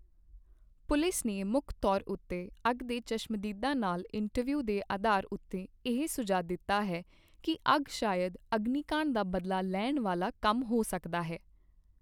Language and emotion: Punjabi, neutral